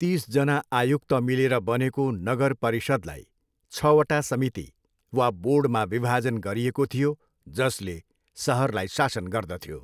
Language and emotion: Nepali, neutral